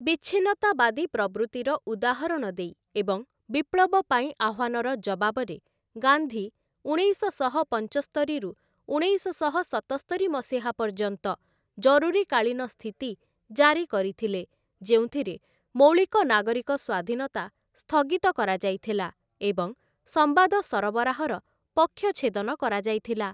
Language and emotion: Odia, neutral